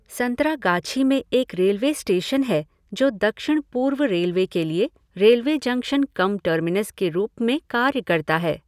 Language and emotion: Hindi, neutral